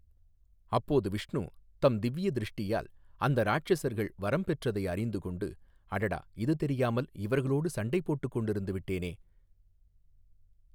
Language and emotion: Tamil, neutral